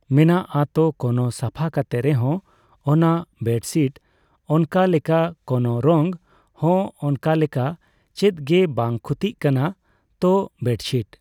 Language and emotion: Santali, neutral